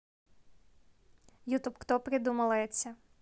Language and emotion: Russian, neutral